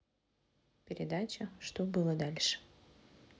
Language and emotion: Russian, neutral